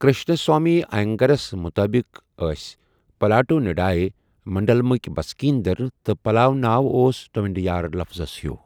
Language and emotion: Kashmiri, neutral